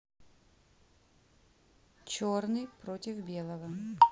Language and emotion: Russian, neutral